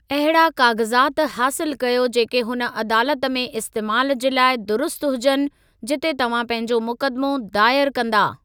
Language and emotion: Sindhi, neutral